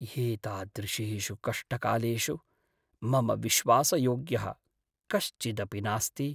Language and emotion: Sanskrit, sad